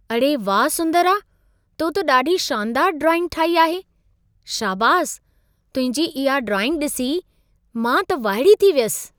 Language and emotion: Sindhi, surprised